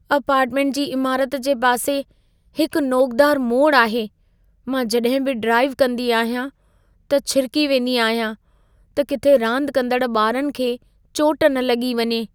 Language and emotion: Sindhi, fearful